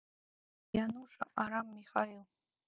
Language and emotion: Russian, neutral